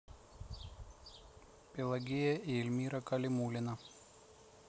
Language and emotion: Russian, neutral